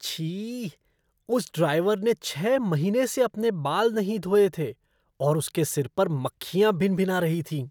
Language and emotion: Hindi, disgusted